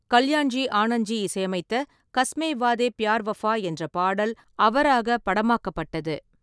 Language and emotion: Tamil, neutral